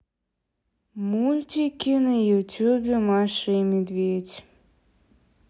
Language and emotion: Russian, sad